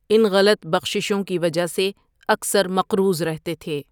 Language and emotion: Urdu, neutral